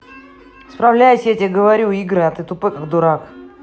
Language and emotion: Russian, angry